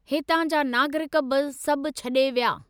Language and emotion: Sindhi, neutral